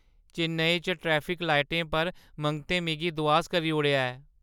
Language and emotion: Dogri, sad